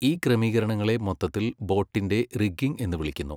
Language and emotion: Malayalam, neutral